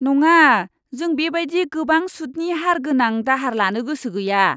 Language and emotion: Bodo, disgusted